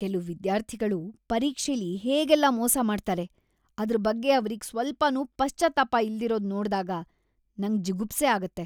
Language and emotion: Kannada, disgusted